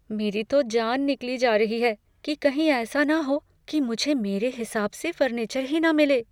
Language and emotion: Hindi, fearful